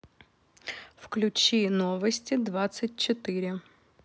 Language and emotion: Russian, neutral